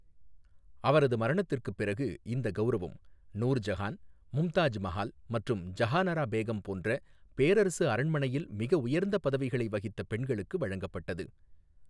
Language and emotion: Tamil, neutral